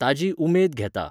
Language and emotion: Goan Konkani, neutral